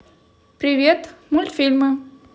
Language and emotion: Russian, positive